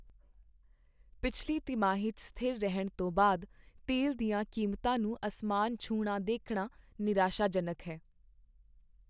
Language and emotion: Punjabi, sad